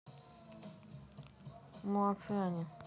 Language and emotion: Russian, neutral